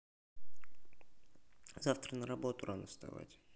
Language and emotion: Russian, neutral